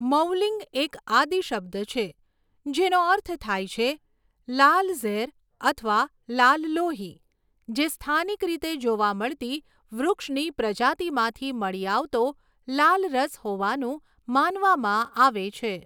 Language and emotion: Gujarati, neutral